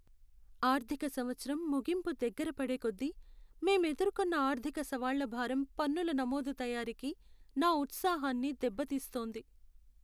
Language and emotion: Telugu, sad